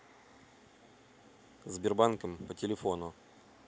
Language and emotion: Russian, neutral